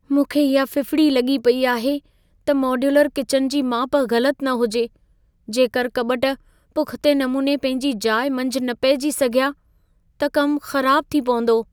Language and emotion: Sindhi, fearful